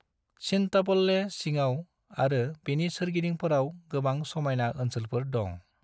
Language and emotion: Bodo, neutral